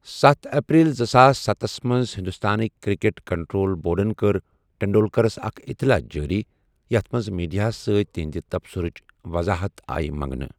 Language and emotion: Kashmiri, neutral